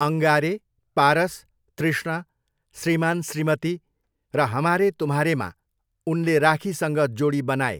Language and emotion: Nepali, neutral